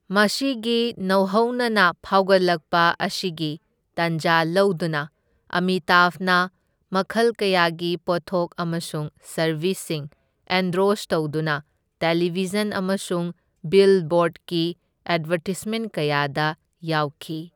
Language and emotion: Manipuri, neutral